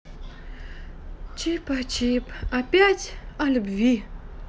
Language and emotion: Russian, sad